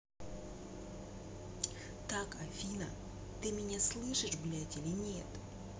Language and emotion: Russian, angry